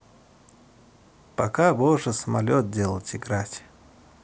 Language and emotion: Russian, neutral